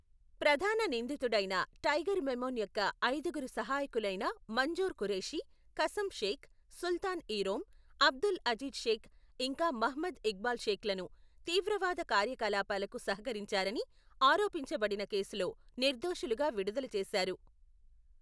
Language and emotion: Telugu, neutral